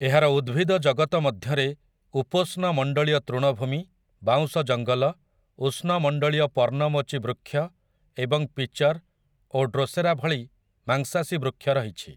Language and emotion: Odia, neutral